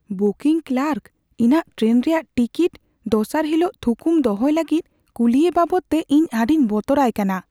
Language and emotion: Santali, fearful